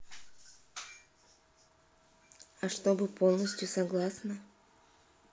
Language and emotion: Russian, neutral